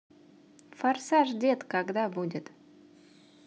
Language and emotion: Russian, positive